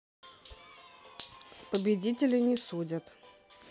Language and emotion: Russian, neutral